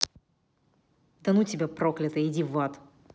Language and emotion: Russian, angry